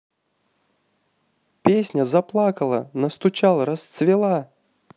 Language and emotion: Russian, positive